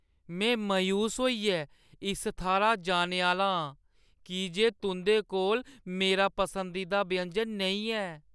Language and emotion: Dogri, sad